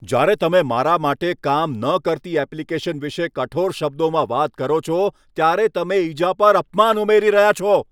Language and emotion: Gujarati, angry